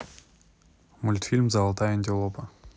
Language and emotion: Russian, neutral